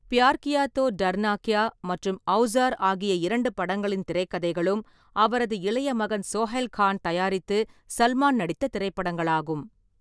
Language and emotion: Tamil, neutral